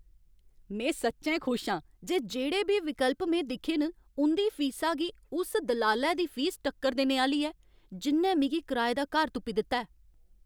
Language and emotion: Dogri, happy